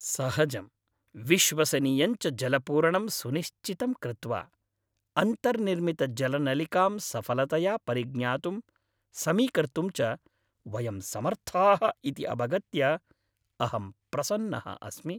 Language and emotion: Sanskrit, happy